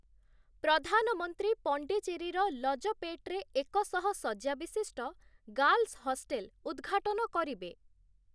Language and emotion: Odia, neutral